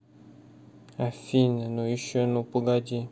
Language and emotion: Russian, sad